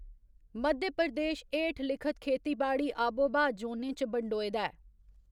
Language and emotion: Dogri, neutral